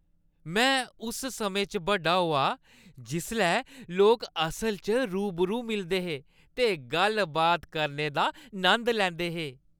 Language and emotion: Dogri, happy